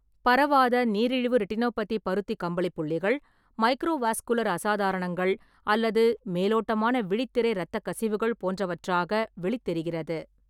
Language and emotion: Tamil, neutral